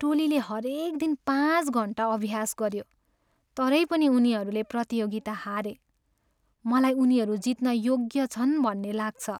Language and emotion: Nepali, sad